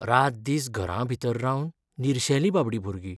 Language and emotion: Goan Konkani, sad